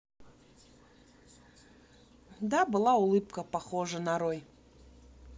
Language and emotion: Russian, neutral